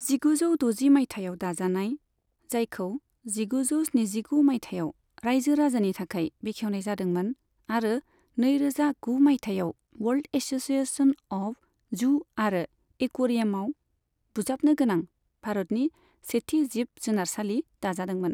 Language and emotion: Bodo, neutral